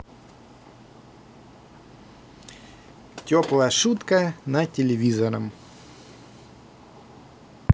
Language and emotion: Russian, positive